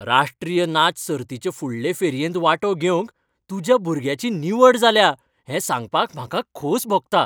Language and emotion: Goan Konkani, happy